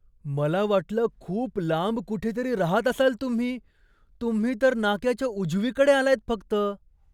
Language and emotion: Marathi, surprised